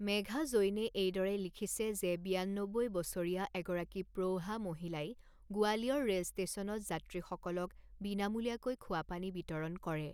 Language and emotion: Assamese, neutral